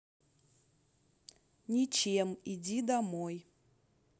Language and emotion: Russian, neutral